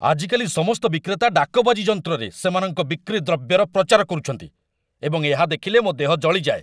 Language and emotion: Odia, angry